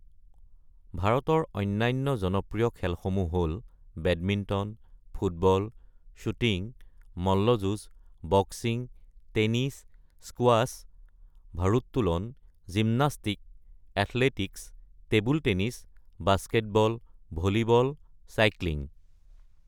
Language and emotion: Assamese, neutral